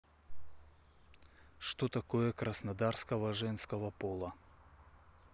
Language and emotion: Russian, neutral